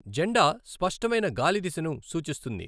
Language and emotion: Telugu, neutral